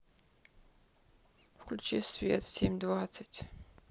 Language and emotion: Russian, neutral